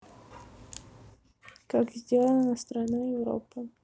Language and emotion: Russian, neutral